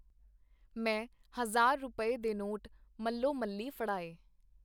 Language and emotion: Punjabi, neutral